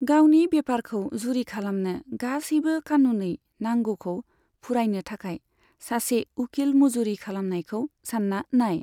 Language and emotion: Bodo, neutral